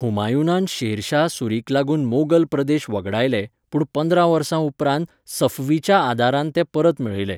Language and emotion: Goan Konkani, neutral